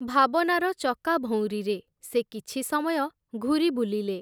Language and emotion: Odia, neutral